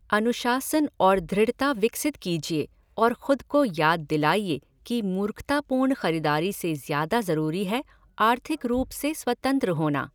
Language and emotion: Hindi, neutral